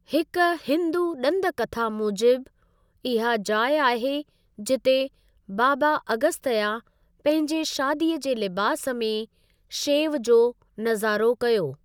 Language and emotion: Sindhi, neutral